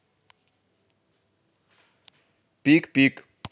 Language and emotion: Russian, positive